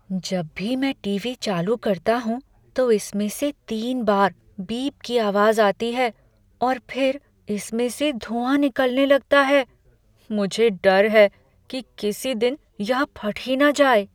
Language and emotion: Hindi, fearful